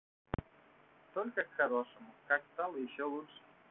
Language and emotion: Russian, neutral